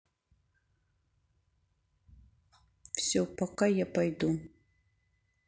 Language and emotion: Russian, sad